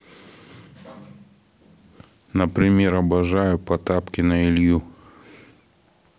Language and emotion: Russian, neutral